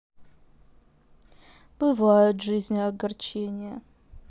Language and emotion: Russian, sad